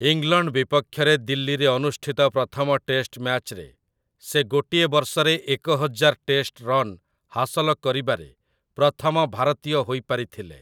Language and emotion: Odia, neutral